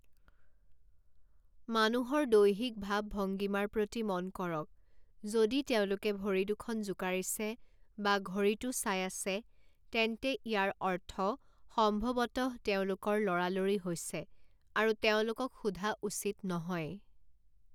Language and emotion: Assamese, neutral